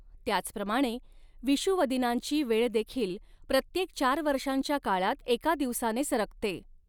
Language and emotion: Marathi, neutral